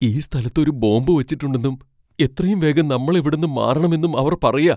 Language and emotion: Malayalam, fearful